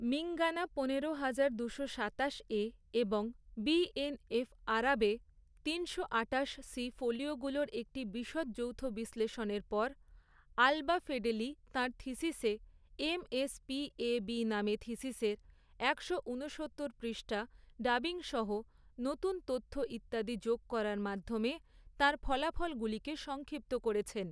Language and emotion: Bengali, neutral